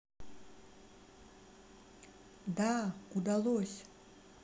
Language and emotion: Russian, sad